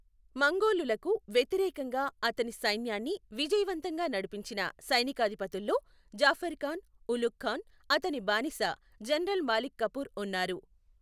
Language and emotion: Telugu, neutral